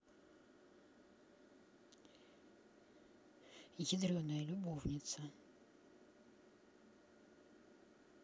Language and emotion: Russian, neutral